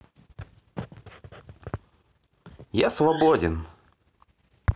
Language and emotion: Russian, positive